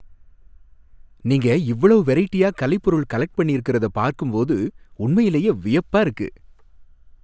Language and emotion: Tamil, happy